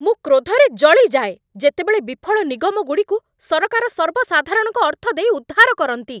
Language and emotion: Odia, angry